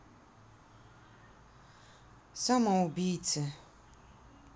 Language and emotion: Russian, sad